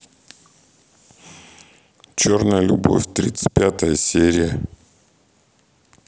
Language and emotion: Russian, neutral